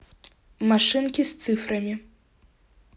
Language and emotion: Russian, neutral